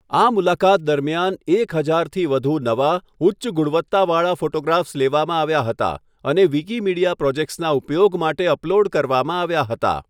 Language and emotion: Gujarati, neutral